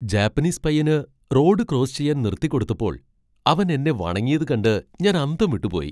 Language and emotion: Malayalam, surprised